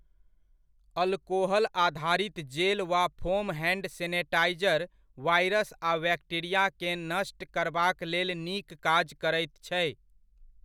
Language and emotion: Maithili, neutral